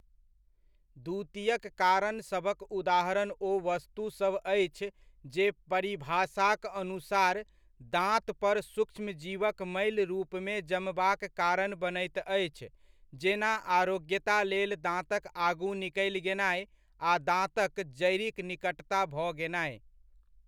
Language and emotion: Maithili, neutral